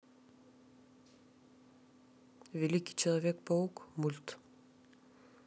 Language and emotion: Russian, neutral